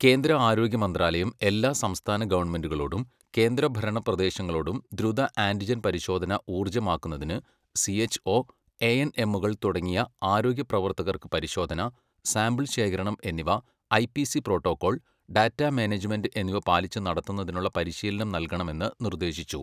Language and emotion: Malayalam, neutral